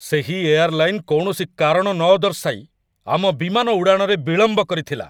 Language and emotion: Odia, angry